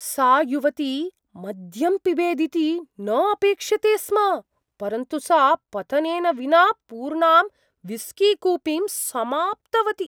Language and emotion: Sanskrit, surprised